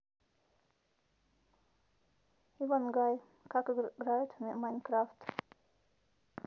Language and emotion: Russian, neutral